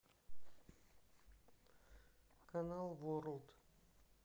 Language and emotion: Russian, neutral